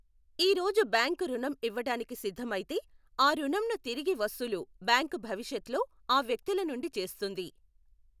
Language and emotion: Telugu, neutral